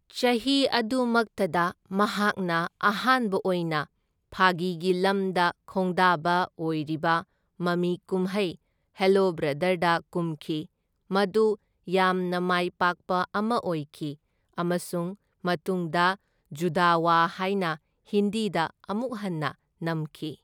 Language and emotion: Manipuri, neutral